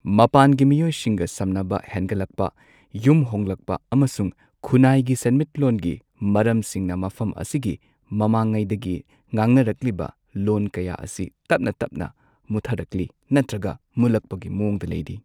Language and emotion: Manipuri, neutral